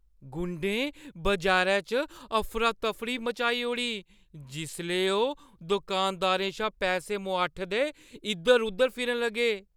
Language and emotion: Dogri, fearful